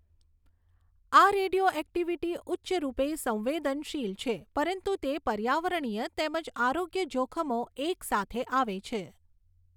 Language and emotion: Gujarati, neutral